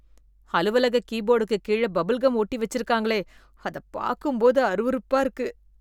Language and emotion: Tamil, disgusted